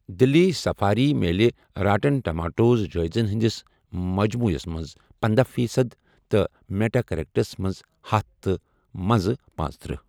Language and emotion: Kashmiri, neutral